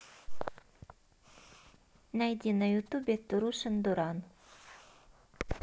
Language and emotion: Russian, neutral